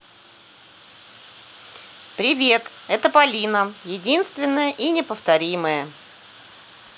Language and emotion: Russian, positive